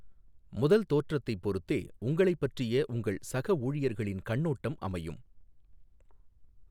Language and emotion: Tamil, neutral